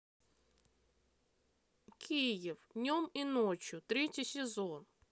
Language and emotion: Russian, neutral